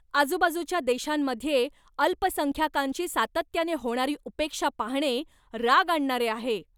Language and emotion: Marathi, angry